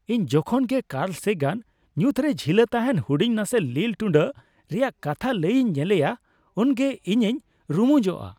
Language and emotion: Santali, happy